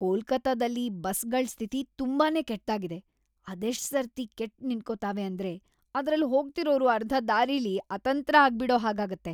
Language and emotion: Kannada, disgusted